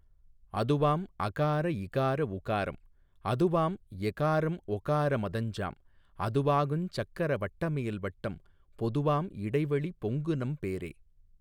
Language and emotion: Tamil, neutral